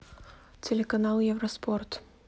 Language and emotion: Russian, neutral